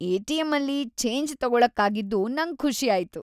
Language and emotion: Kannada, happy